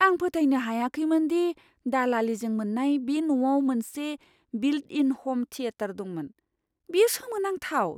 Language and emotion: Bodo, surprised